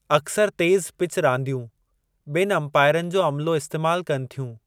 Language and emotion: Sindhi, neutral